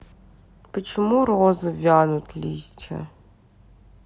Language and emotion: Russian, sad